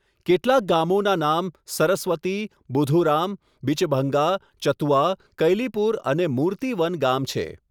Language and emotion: Gujarati, neutral